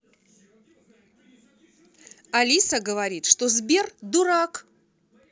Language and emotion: Russian, neutral